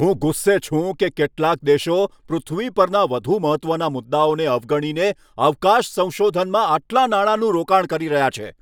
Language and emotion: Gujarati, angry